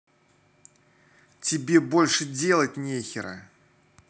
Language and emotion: Russian, angry